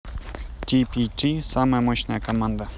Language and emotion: Russian, neutral